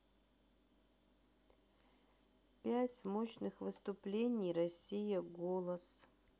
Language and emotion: Russian, sad